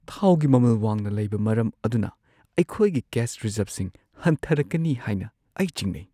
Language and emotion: Manipuri, fearful